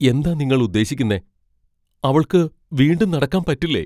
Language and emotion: Malayalam, fearful